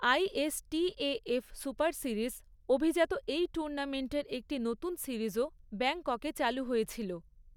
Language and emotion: Bengali, neutral